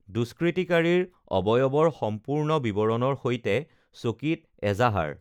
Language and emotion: Assamese, neutral